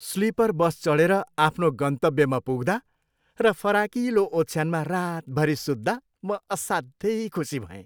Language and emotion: Nepali, happy